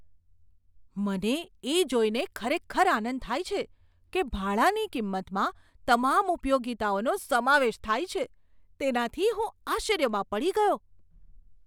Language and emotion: Gujarati, surprised